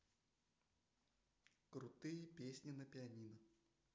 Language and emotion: Russian, neutral